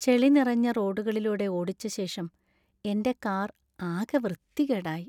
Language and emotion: Malayalam, sad